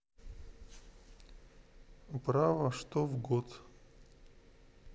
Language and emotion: Russian, neutral